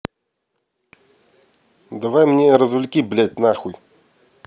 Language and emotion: Russian, angry